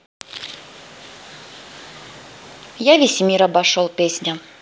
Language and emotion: Russian, neutral